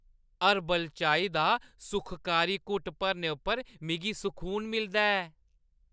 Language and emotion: Dogri, happy